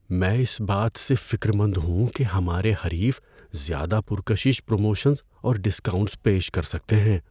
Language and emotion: Urdu, fearful